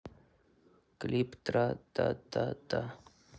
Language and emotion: Russian, sad